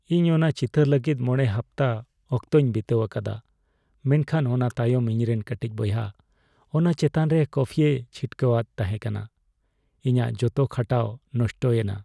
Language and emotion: Santali, sad